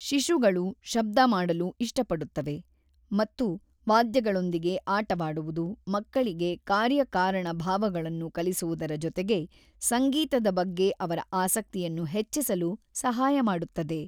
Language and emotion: Kannada, neutral